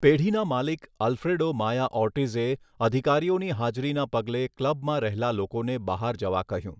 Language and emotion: Gujarati, neutral